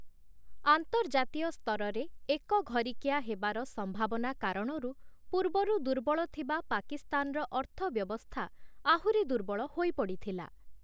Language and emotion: Odia, neutral